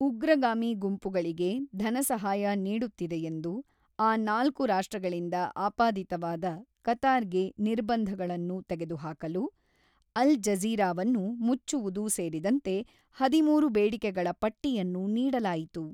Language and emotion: Kannada, neutral